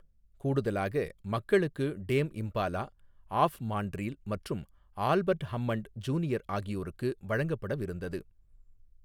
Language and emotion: Tamil, neutral